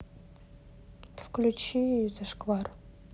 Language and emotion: Russian, neutral